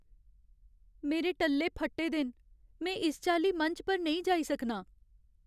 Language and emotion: Dogri, sad